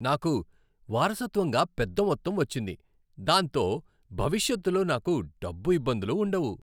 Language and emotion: Telugu, happy